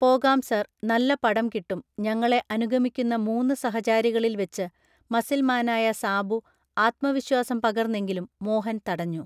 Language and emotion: Malayalam, neutral